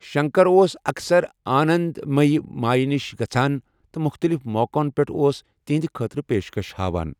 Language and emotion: Kashmiri, neutral